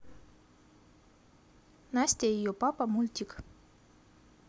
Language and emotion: Russian, neutral